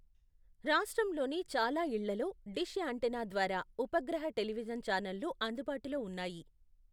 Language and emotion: Telugu, neutral